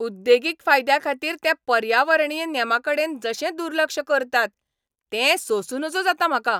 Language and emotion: Goan Konkani, angry